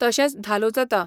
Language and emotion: Goan Konkani, neutral